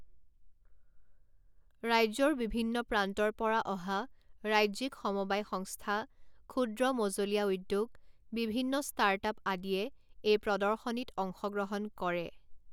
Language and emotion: Assamese, neutral